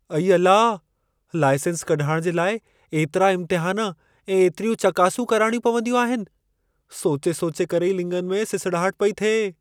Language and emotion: Sindhi, fearful